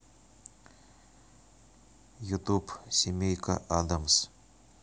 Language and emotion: Russian, neutral